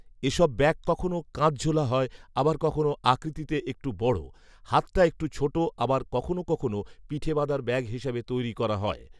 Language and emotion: Bengali, neutral